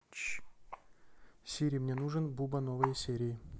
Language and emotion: Russian, neutral